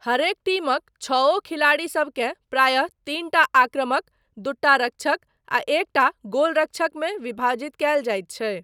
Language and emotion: Maithili, neutral